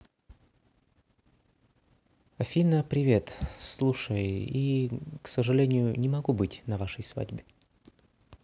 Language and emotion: Russian, sad